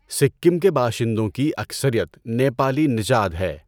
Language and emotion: Urdu, neutral